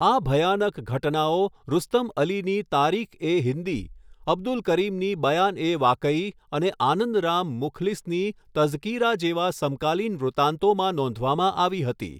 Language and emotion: Gujarati, neutral